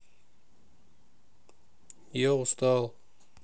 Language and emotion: Russian, sad